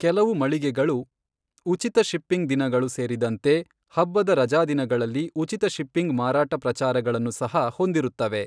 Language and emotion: Kannada, neutral